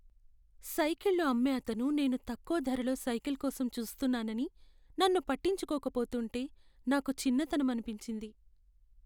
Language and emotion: Telugu, sad